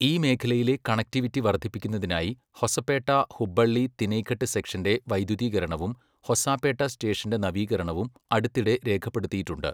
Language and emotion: Malayalam, neutral